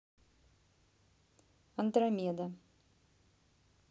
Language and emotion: Russian, neutral